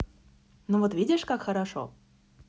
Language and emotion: Russian, positive